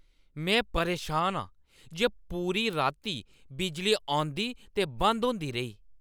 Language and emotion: Dogri, angry